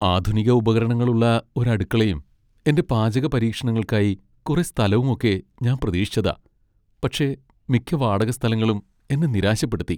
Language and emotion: Malayalam, sad